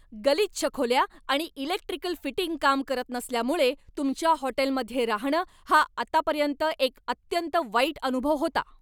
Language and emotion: Marathi, angry